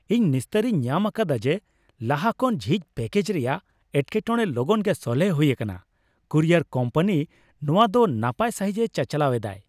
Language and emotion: Santali, happy